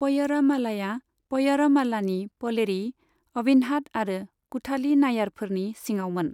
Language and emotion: Bodo, neutral